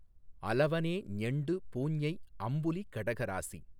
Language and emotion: Tamil, neutral